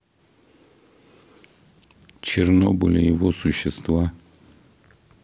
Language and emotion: Russian, neutral